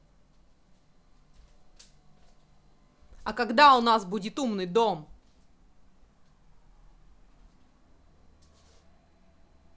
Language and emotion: Russian, angry